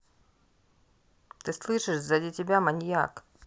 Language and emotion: Russian, neutral